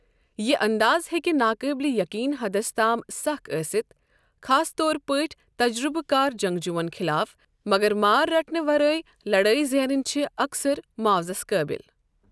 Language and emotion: Kashmiri, neutral